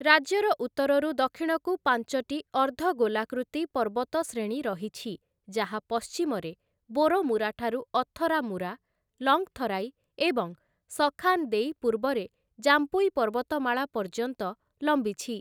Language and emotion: Odia, neutral